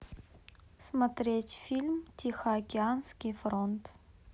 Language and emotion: Russian, neutral